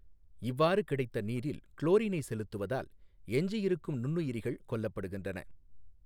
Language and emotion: Tamil, neutral